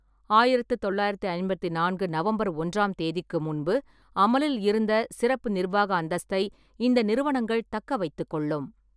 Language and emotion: Tamil, neutral